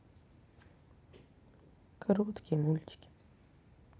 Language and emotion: Russian, sad